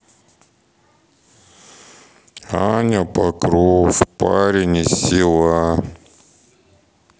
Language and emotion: Russian, sad